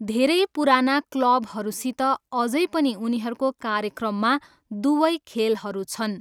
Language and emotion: Nepali, neutral